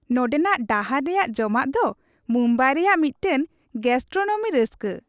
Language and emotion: Santali, happy